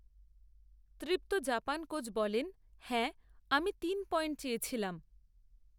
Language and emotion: Bengali, neutral